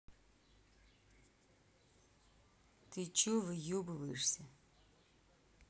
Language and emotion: Russian, angry